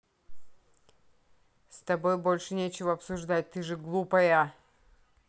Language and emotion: Russian, angry